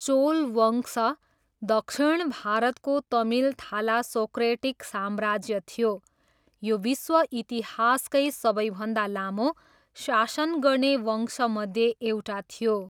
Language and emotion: Nepali, neutral